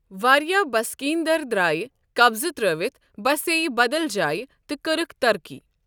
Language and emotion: Kashmiri, neutral